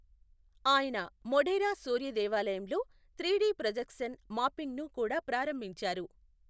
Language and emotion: Telugu, neutral